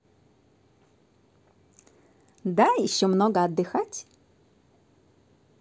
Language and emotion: Russian, positive